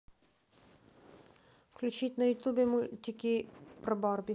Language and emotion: Russian, neutral